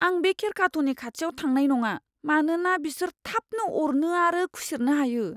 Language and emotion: Bodo, fearful